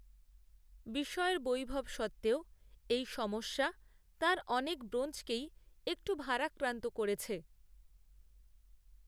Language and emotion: Bengali, neutral